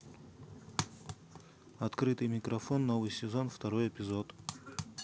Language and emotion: Russian, neutral